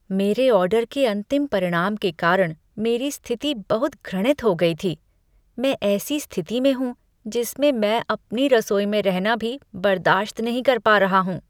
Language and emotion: Hindi, disgusted